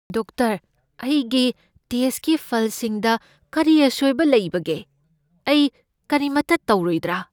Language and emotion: Manipuri, fearful